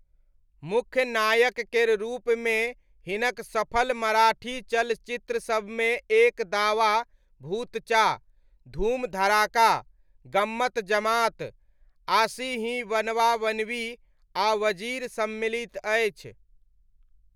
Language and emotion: Maithili, neutral